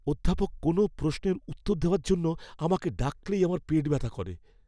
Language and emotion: Bengali, fearful